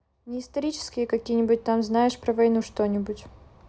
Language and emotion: Russian, neutral